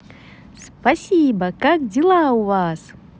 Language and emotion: Russian, positive